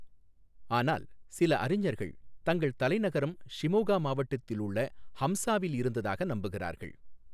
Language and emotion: Tamil, neutral